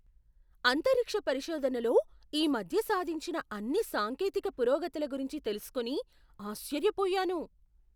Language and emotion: Telugu, surprised